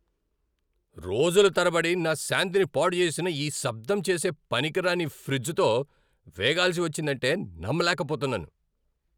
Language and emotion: Telugu, angry